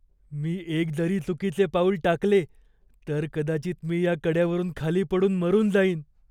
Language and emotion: Marathi, fearful